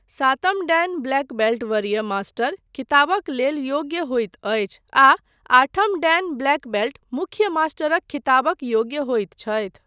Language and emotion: Maithili, neutral